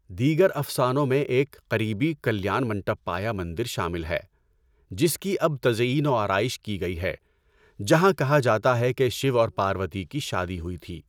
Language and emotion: Urdu, neutral